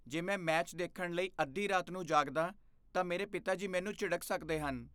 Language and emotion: Punjabi, fearful